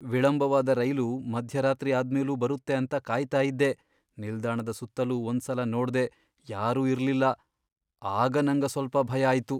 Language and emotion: Kannada, fearful